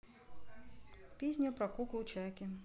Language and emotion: Russian, neutral